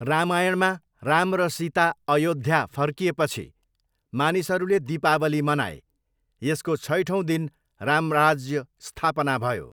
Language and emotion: Nepali, neutral